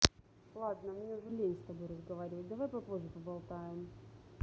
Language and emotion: Russian, neutral